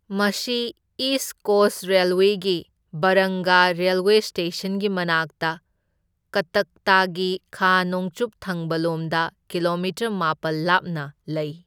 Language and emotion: Manipuri, neutral